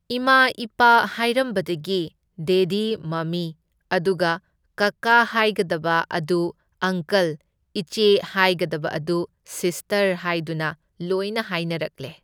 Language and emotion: Manipuri, neutral